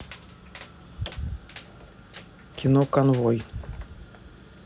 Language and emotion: Russian, neutral